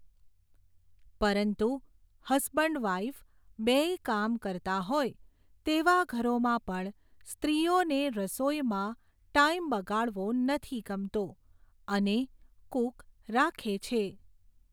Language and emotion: Gujarati, neutral